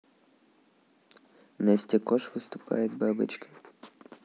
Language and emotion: Russian, neutral